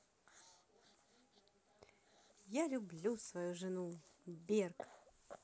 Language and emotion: Russian, positive